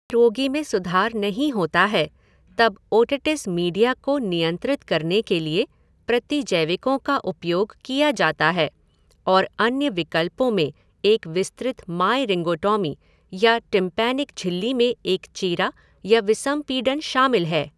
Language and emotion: Hindi, neutral